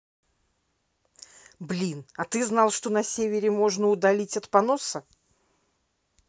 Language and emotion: Russian, angry